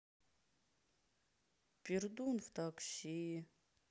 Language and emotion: Russian, sad